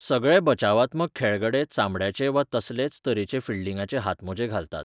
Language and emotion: Goan Konkani, neutral